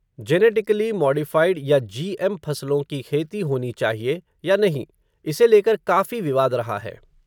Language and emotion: Hindi, neutral